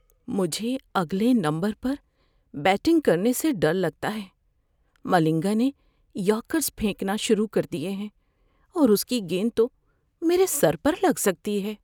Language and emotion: Urdu, fearful